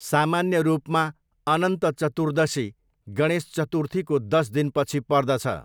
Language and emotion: Nepali, neutral